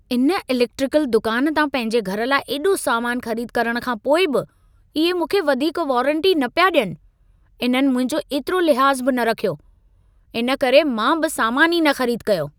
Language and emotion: Sindhi, angry